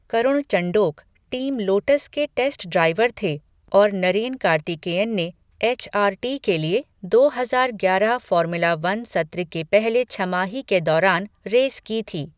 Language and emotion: Hindi, neutral